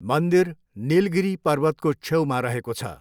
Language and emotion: Nepali, neutral